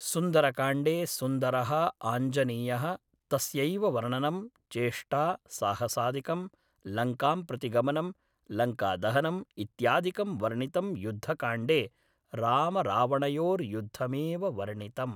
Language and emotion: Sanskrit, neutral